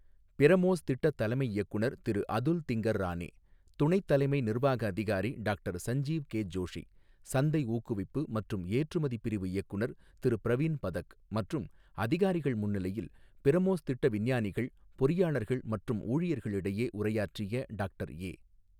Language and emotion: Tamil, neutral